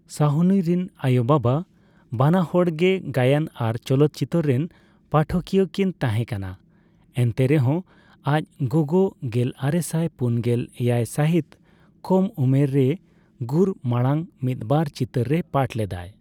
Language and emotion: Santali, neutral